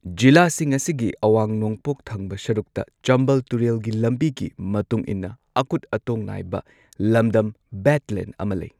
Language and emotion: Manipuri, neutral